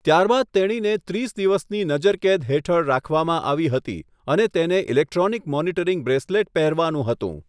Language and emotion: Gujarati, neutral